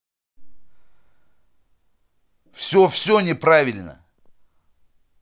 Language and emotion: Russian, angry